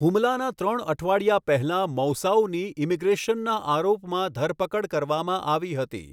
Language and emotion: Gujarati, neutral